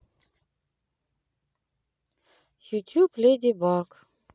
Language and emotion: Russian, sad